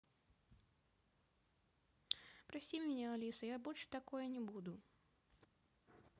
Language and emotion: Russian, neutral